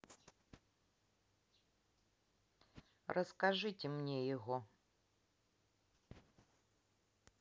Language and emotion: Russian, neutral